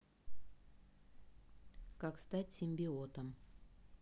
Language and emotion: Russian, neutral